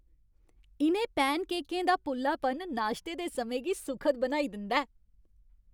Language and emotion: Dogri, happy